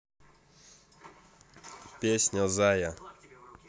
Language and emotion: Russian, neutral